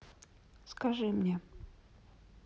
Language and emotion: Russian, neutral